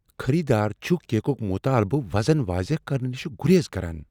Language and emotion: Kashmiri, fearful